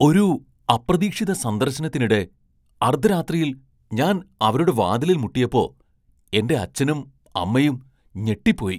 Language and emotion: Malayalam, surprised